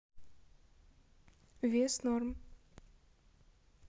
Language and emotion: Russian, neutral